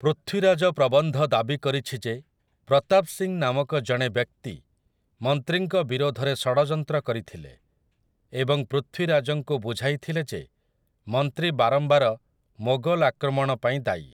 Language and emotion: Odia, neutral